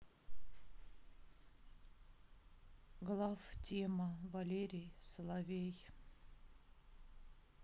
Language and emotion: Russian, sad